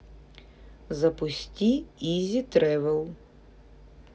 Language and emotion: Russian, neutral